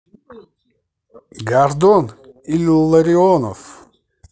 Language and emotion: Russian, positive